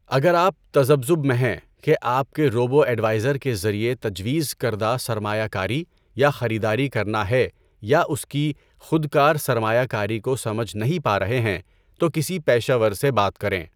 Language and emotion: Urdu, neutral